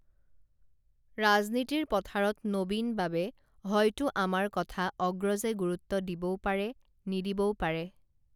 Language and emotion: Assamese, neutral